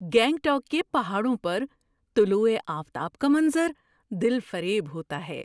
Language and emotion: Urdu, surprised